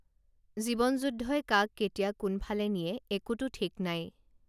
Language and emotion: Assamese, neutral